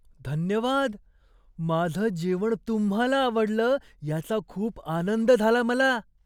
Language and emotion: Marathi, surprised